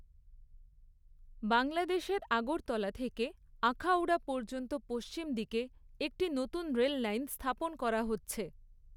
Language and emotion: Bengali, neutral